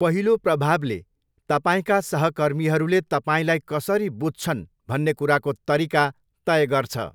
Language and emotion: Nepali, neutral